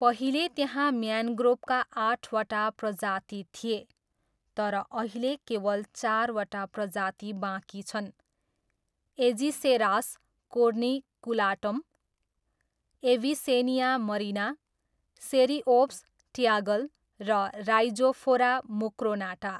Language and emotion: Nepali, neutral